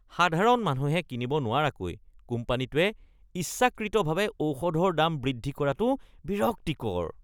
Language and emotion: Assamese, disgusted